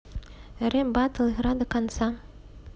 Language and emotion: Russian, neutral